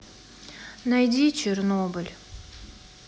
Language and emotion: Russian, sad